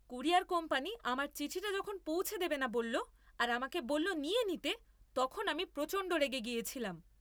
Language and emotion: Bengali, angry